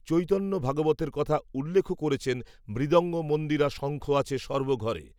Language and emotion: Bengali, neutral